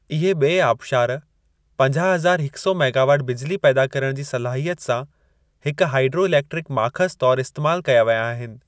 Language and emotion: Sindhi, neutral